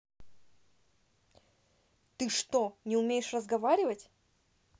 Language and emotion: Russian, angry